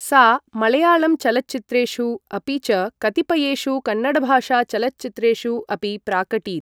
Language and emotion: Sanskrit, neutral